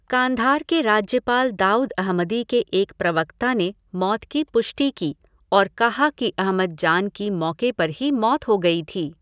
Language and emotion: Hindi, neutral